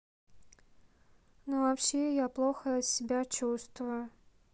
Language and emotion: Russian, sad